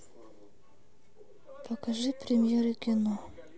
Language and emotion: Russian, sad